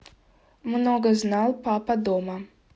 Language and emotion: Russian, neutral